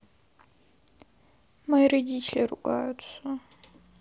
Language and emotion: Russian, sad